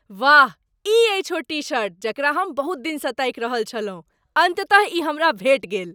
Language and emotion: Maithili, surprised